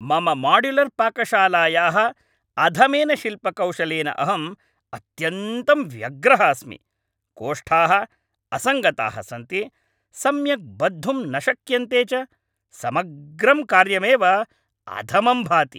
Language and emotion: Sanskrit, angry